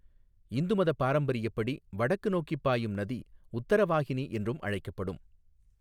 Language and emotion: Tamil, neutral